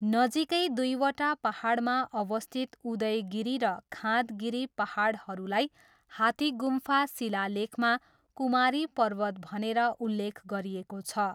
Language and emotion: Nepali, neutral